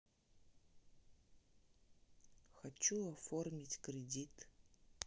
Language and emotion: Russian, sad